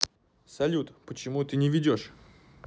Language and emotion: Russian, neutral